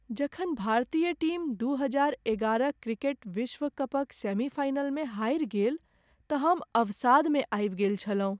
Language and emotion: Maithili, sad